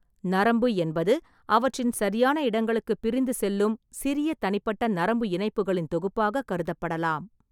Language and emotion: Tamil, neutral